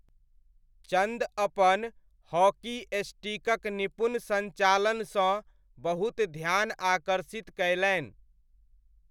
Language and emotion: Maithili, neutral